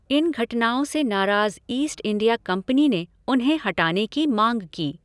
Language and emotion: Hindi, neutral